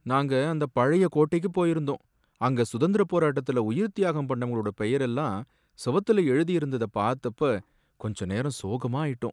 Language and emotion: Tamil, sad